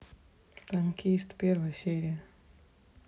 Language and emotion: Russian, neutral